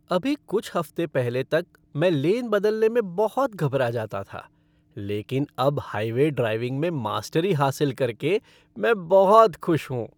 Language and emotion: Hindi, happy